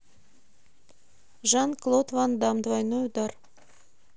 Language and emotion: Russian, neutral